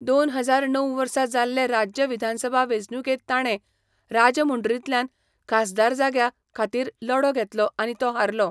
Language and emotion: Goan Konkani, neutral